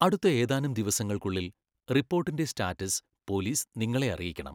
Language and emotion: Malayalam, neutral